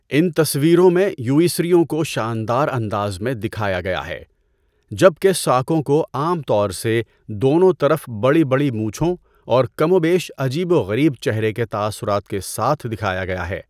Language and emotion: Urdu, neutral